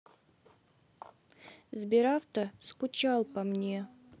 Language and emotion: Russian, sad